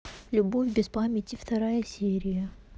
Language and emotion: Russian, neutral